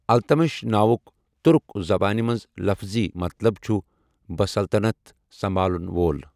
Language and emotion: Kashmiri, neutral